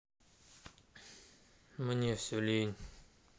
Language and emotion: Russian, sad